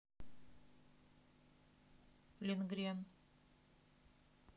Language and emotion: Russian, neutral